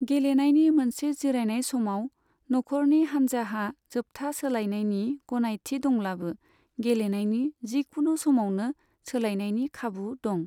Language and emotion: Bodo, neutral